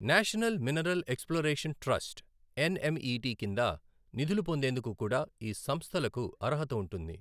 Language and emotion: Telugu, neutral